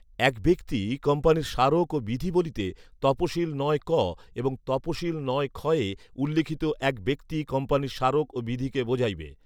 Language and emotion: Bengali, neutral